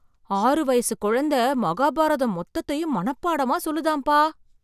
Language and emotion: Tamil, surprised